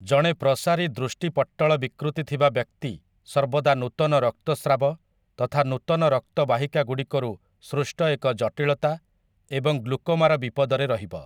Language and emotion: Odia, neutral